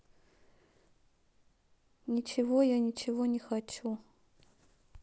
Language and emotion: Russian, sad